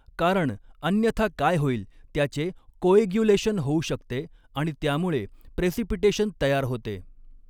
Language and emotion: Marathi, neutral